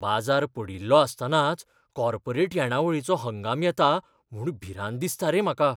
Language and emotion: Goan Konkani, fearful